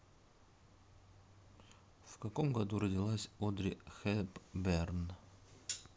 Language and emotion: Russian, neutral